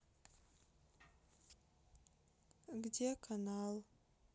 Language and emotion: Russian, sad